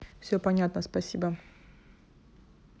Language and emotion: Russian, neutral